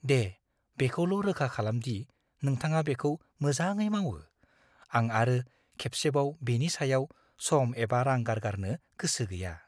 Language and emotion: Bodo, fearful